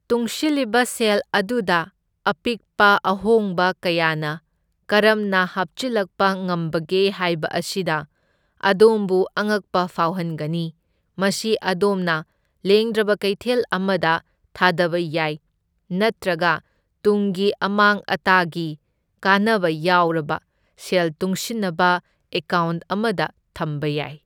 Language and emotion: Manipuri, neutral